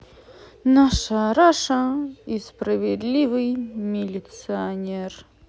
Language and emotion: Russian, positive